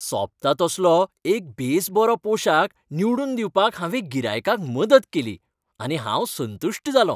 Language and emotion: Goan Konkani, happy